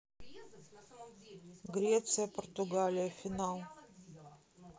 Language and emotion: Russian, neutral